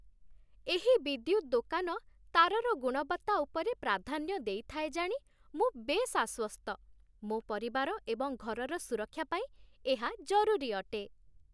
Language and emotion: Odia, happy